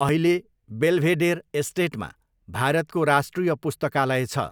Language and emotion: Nepali, neutral